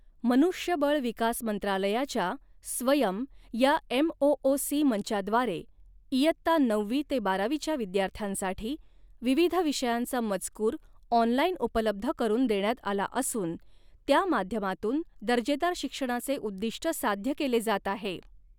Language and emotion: Marathi, neutral